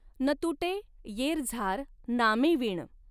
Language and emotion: Marathi, neutral